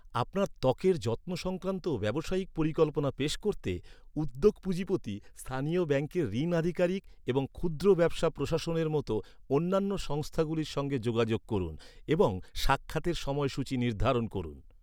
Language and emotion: Bengali, neutral